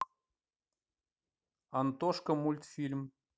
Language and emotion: Russian, neutral